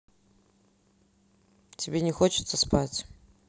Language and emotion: Russian, neutral